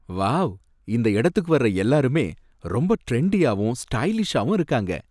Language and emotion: Tamil, happy